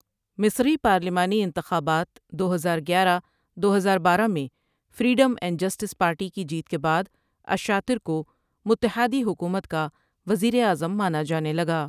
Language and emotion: Urdu, neutral